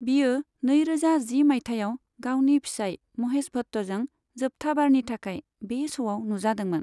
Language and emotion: Bodo, neutral